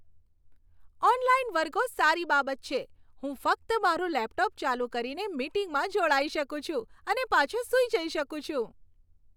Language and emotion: Gujarati, happy